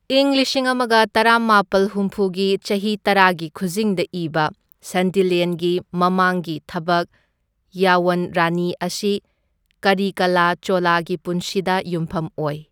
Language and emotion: Manipuri, neutral